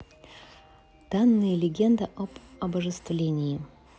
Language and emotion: Russian, neutral